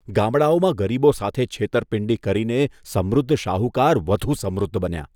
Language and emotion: Gujarati, disgusted